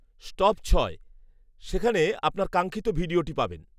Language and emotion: Bengali, neutral